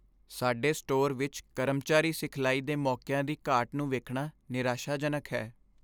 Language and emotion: Punjabi, sad